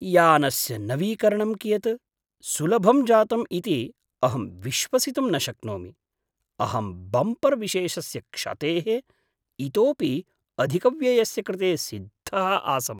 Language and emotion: Sanskrit, surprised